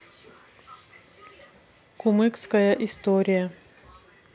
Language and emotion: Russian, neutral